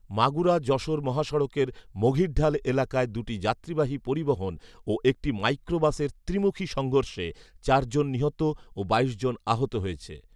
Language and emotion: Bengali, neutral